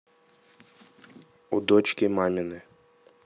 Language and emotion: Russian, neutral